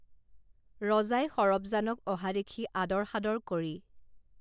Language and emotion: Assamese, neutral